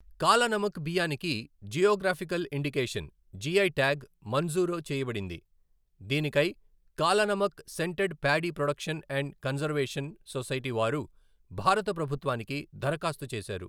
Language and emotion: Telugu, neutral